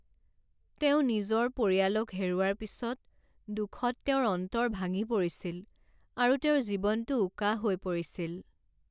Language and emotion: Assamese, sad